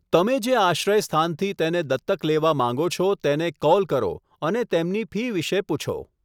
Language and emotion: Gujarati, neutral